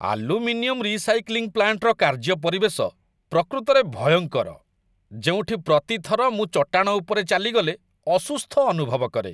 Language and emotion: Odia, disgusted